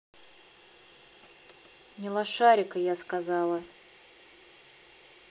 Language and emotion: Russian, angry